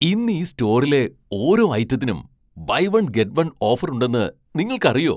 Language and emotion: Malayalam, surprised